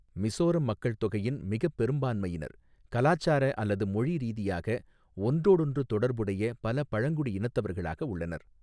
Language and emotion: Tamil, neutral